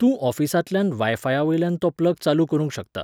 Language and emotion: Goan Konkani, neutral